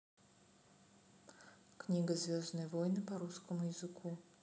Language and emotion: Russian, neutral